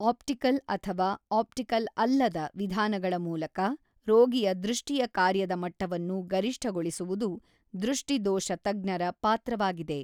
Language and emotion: Kannada, neutral